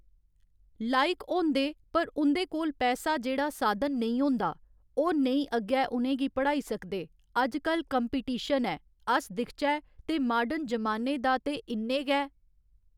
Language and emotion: Dogri, neutral